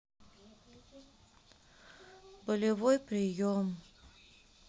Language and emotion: Russian, sad